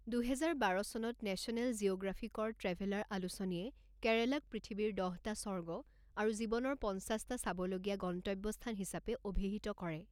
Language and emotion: Assamese, neutral